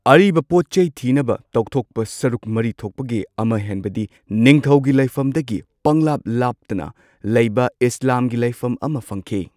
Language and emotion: Manipuri, neutral